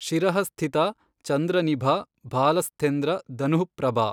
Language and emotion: Kannada, neutral